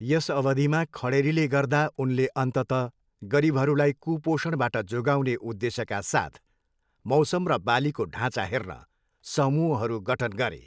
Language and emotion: Nepali, neutral